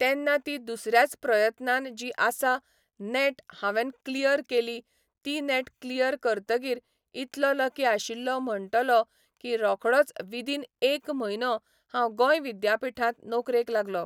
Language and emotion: Goan Konkani, neutral